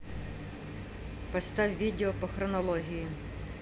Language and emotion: Russian, angry